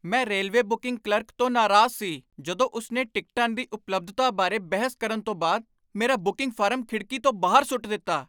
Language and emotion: Punjabi, angry